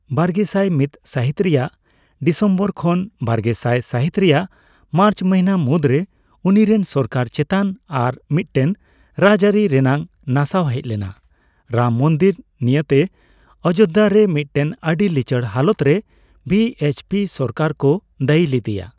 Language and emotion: Santali, neutral